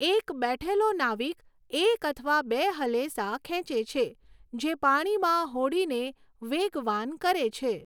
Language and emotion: Gujarati, neutral